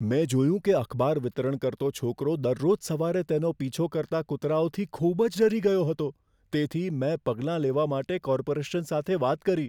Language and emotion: Gujarati, fearful